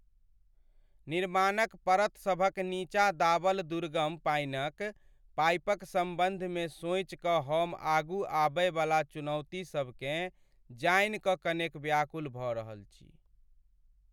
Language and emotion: Maithili, sad